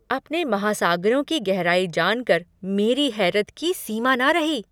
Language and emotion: Hindi, surprised